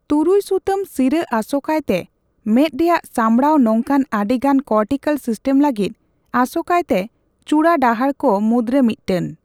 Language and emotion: Santali, neutral